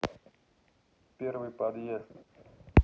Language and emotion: Russian, neutral